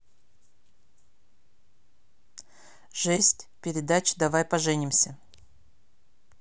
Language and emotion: Russian, neutral